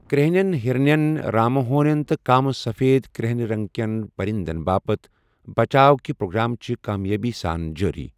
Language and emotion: Kashmiri, neutral